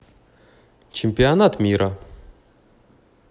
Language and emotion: Russian, neutral